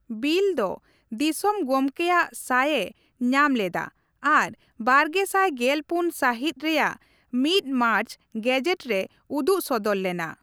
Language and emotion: Santali, neutral